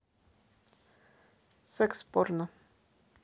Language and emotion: Russian, neutral